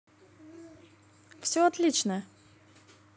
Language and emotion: Russian, positive